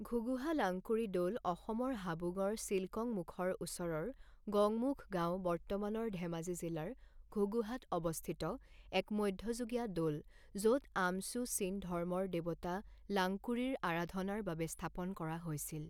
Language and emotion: Assamese, neutral